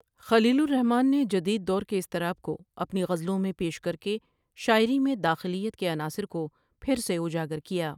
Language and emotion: Urdu, neutral